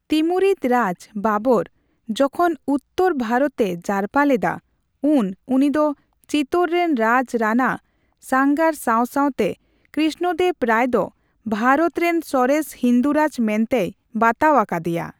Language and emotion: Santali, neutral